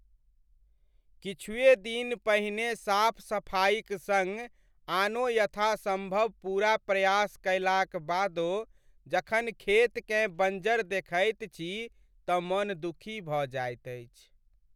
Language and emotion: Maithili, sad